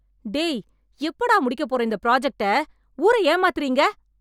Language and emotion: Tamil, angry